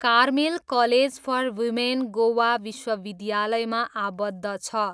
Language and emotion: Nepali, neutral